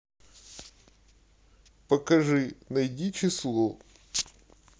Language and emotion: Russian, sad